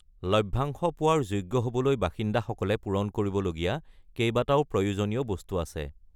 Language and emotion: Assamese, neutral